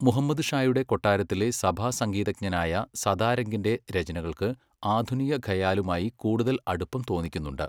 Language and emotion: Malayalam, neutral